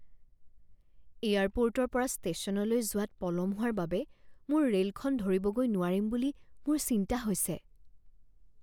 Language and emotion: Assamese, fearful